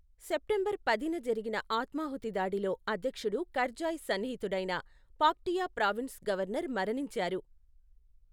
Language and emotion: Telugu, neutral